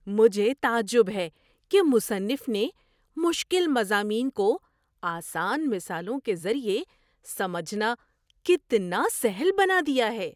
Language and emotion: Urdu, surprised